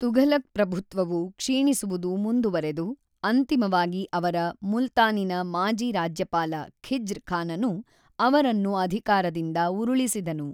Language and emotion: Kannada, neutral